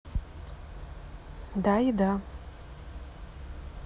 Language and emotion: Russian, neutral